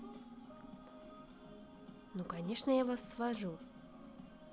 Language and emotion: Russian, positive